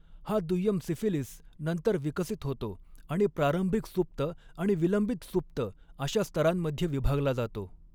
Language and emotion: Marathi, neutral